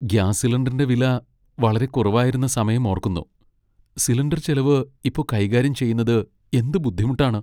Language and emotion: Malayalam, sad